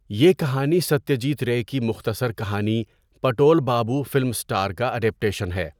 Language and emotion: Urdu, neutral